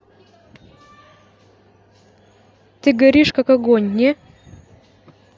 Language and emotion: Russian, neutral